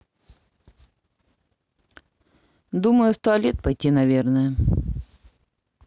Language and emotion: Russian, neutral